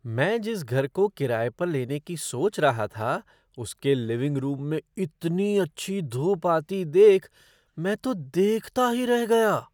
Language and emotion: Hindi, surprised